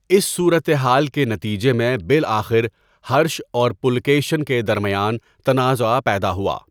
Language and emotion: Urdu, neutral